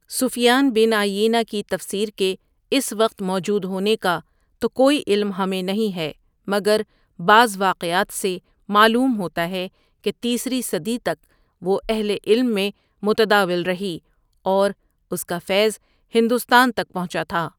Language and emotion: Urdu, neutral